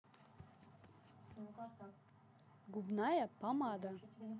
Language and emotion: Russian, neutral